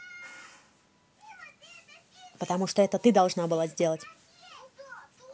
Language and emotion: Russian, angry